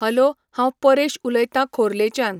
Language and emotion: Goan Konkani, neutral